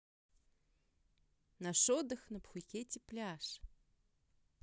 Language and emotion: Russian, positive